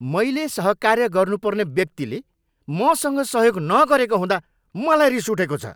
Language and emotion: Nepali, angry